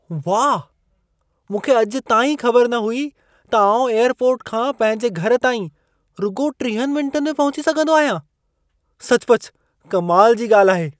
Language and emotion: Sindhi, surprised